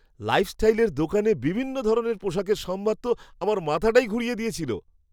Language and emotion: Bengali, surprised